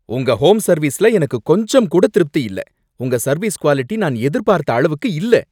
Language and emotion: Tamil, angry